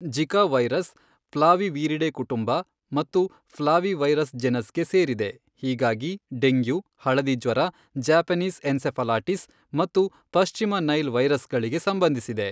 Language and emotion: Kannada, neutral